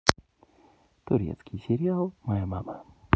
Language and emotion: Russian, neutral